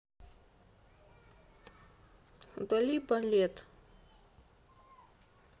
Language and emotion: Russian, neutral